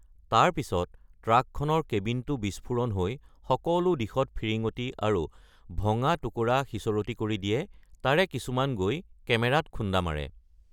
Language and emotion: Assamese, neutral